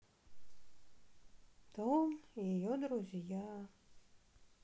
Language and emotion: Russian, sad